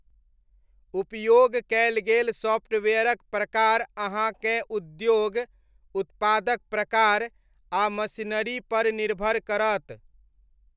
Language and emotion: Maithili, neutral